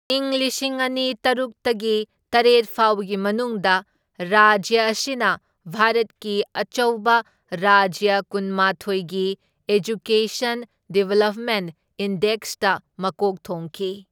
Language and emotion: Manipuri, neutral